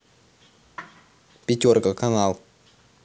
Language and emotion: Russian, neutral